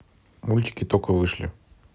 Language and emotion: Russian, neutral